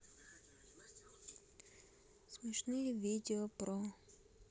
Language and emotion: Russian, sad